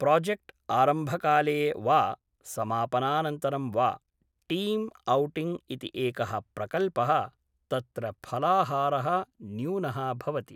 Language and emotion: Sanskrit, neutral